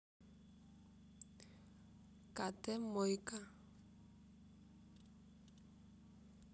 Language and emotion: Russian, neutral